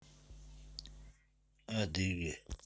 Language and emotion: Russian, neutral